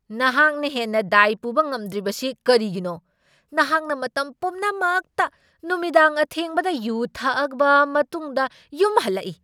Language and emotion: Manipuri, angry